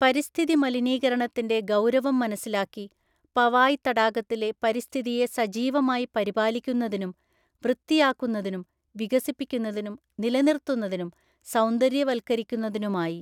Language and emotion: Malayalam, neutral